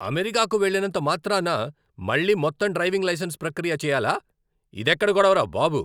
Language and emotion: Telugu, angry